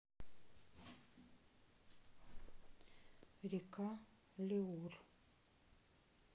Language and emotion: Russian, neutral